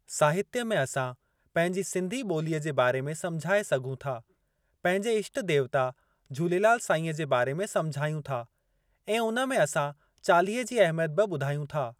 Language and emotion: Sindhi, neutral